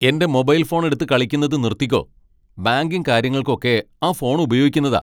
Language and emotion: Malayalam, angry